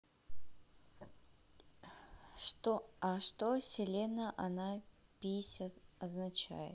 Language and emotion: Russian, neutral